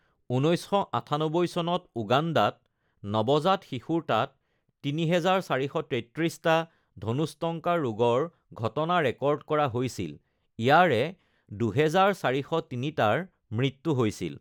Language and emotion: Assamese, neutral